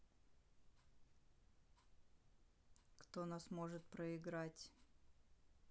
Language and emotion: Russian, neutral